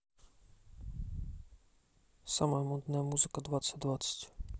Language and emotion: Russian, neutral